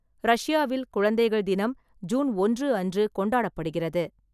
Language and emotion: Tamil, neutral